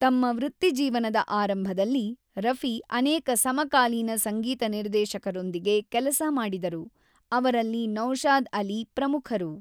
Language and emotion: Kannada, neutral